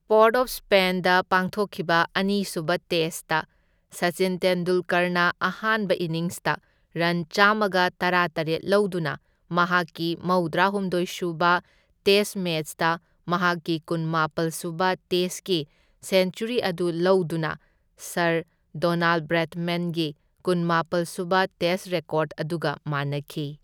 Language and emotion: Manipuri, neutral